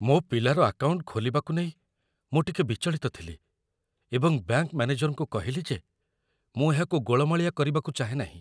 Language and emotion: Odia, fearful